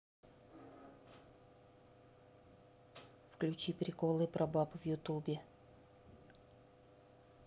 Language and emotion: Russian, neutral